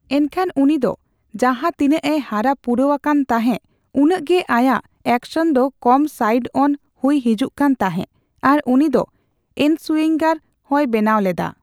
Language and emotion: Santali, neutral